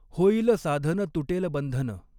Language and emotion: Marathi, neutral